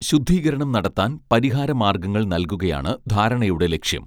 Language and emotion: Malayalam, neutral